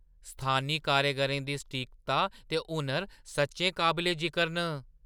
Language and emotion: Dogri, surprised